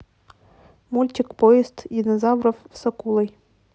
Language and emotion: Russian, neutral